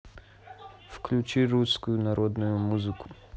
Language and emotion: Russian, neutral